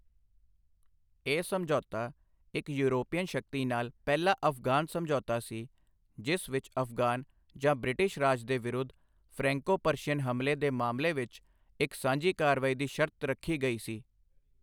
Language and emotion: Punjabi, neutral